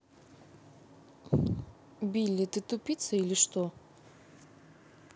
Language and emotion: Russian, angry